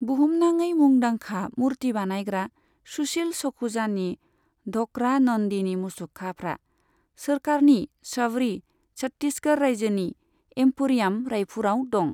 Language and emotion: Bodo, neutral